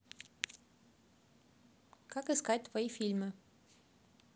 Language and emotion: Russian, neutral